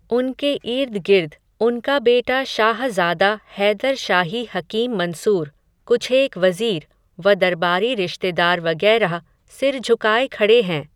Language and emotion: Hindi, neutral